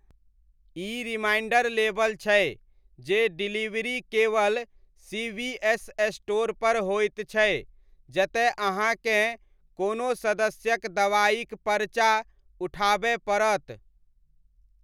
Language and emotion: Maithili, neutral